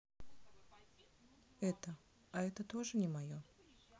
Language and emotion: Russian, sad